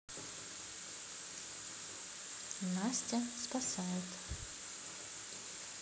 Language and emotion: Russian, neutral